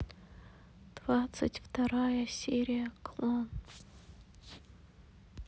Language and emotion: Russian, sad